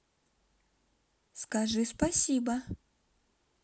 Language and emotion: Russian, positive